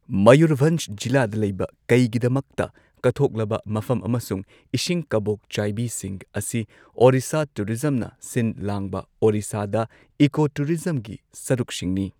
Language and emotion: Manipuri, neutral